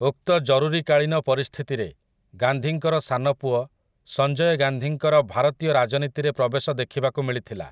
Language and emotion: Odia, neutral